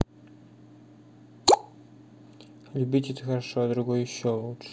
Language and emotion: Russian, neutral